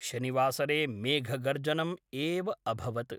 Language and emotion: Sanskrit, neutral